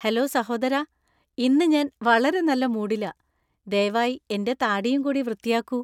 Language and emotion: Malayalam, happy